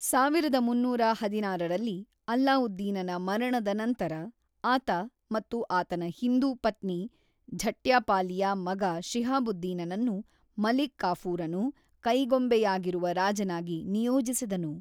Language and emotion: Kannada, neutral